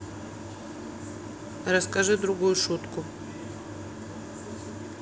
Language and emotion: Russian, neutral